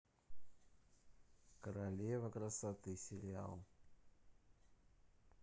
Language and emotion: Russian, neutral